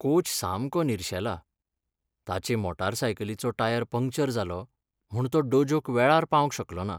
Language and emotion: Goan Konkani, sad